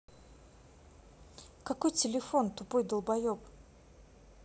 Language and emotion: Russian, angry